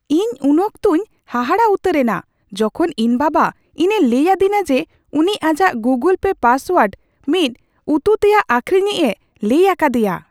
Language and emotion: Santali, surprised